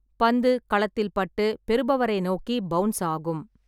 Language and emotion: Tamil, neutral